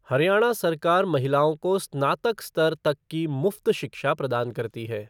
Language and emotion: Hindi, neutral